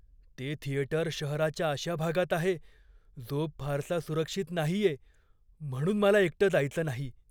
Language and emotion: Marathi, fearful